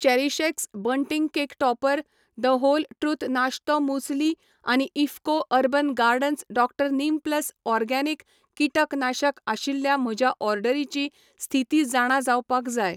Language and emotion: Goan Konkani, neutral